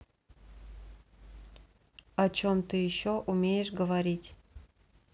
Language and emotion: Russian, neutral